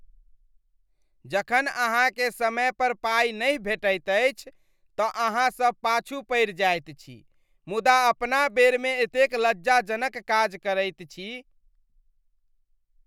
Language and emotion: Maithili, disgusted